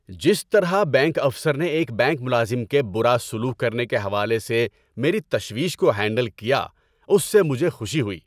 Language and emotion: Urdu, happy